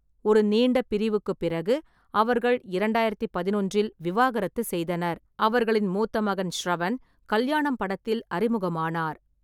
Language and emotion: Tamil, neutral